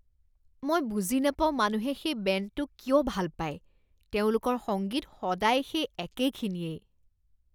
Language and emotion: Assamese, disgusted